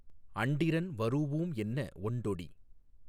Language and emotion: Tamil, neutral